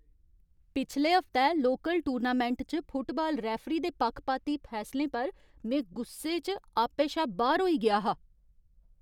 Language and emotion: Dogri, angry